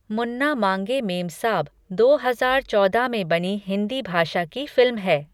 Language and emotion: Hindi, neutral